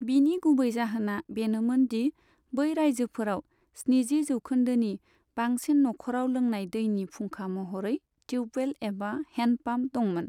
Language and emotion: Bodo, neutral